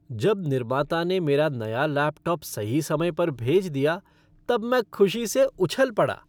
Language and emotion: Hindi, happy